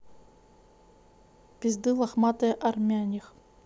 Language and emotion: Russian, neutral